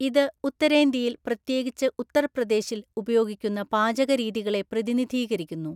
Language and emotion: Malayalam, neutral